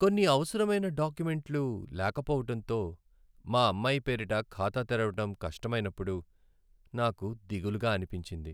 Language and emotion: Telugu, sad